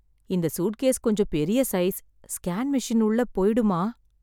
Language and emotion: Tamil, sad